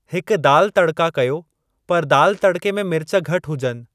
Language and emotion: Sindhi, neutral